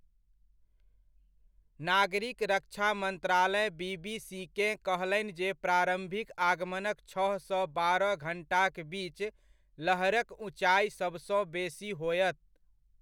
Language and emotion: Maithili, neutral